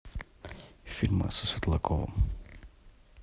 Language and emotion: Russian, neutral